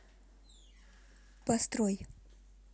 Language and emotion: Russian, neutral